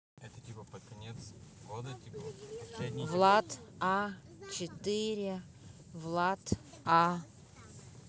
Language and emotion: Russian, neutral